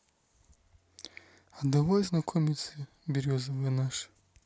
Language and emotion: Russian, neutral